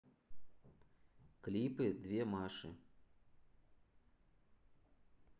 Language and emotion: Russian, neutral